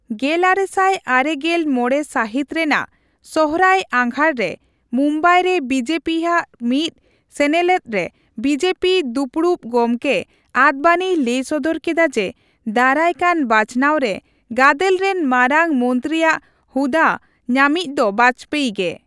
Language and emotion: Santali, neutral